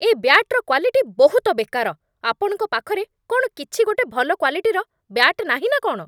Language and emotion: Odia, angry